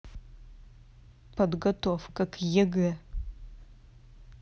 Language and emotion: Russian, angry